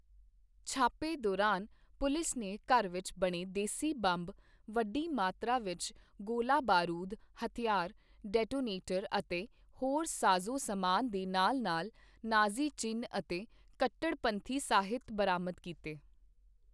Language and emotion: Punjabi, neutral